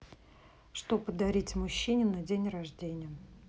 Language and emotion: Russian, neutral